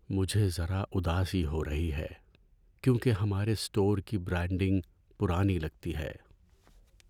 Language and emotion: Urdu, sad